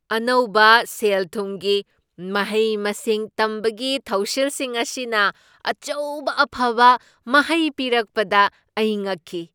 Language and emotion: Manipuri, surprised